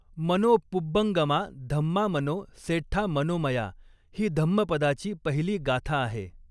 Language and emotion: Marathi, neutral